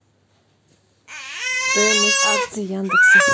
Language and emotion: Russian, neutral